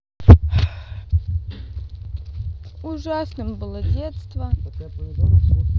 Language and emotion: Russian, sad